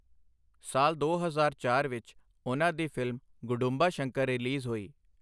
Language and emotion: Punjabi, neutral